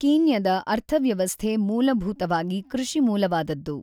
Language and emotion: Kannada, neutral